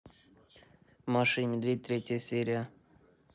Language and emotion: Russian, neutral